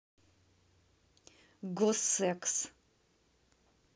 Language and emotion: Russian, neutral